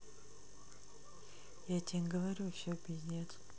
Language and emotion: Russian, neutral